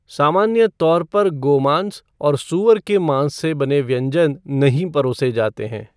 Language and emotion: Hindi, neutral